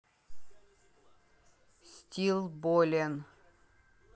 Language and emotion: Russian, neutral